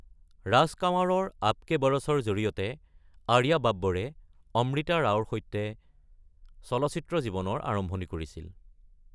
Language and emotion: Assamese, neutral